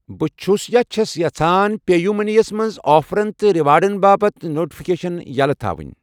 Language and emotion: Kashmiri, neutral